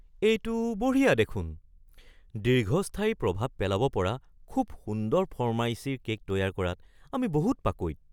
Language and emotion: Assamese, surprised